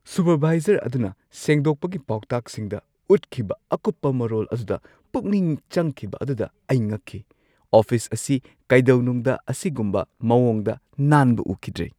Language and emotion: Manipuri, surprised